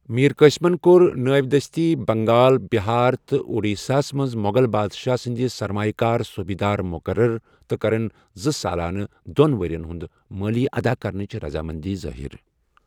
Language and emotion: Kashmiri, neutral